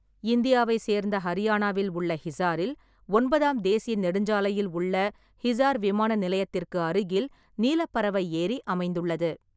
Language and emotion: Tamil, neutral